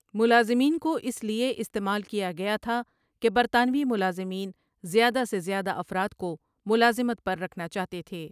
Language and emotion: Urdu, neutral